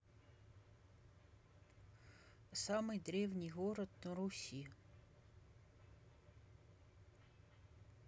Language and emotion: Russian, neutral